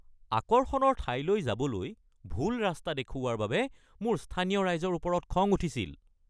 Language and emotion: Assamese, angry